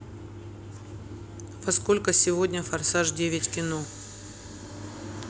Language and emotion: Russian, neutral